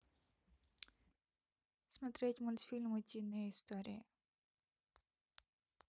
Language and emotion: Russian, neutral